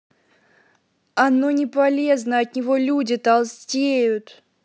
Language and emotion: Russian, angry